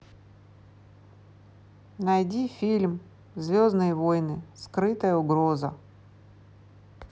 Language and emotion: Russian, neutral